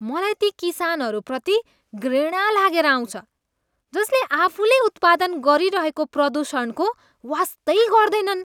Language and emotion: Nepali, disgusted